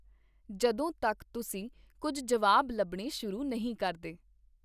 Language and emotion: Punjabi, neutral